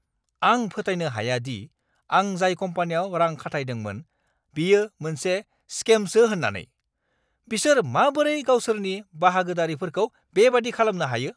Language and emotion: Bodo, angry